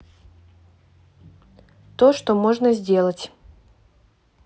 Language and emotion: Russian, neutral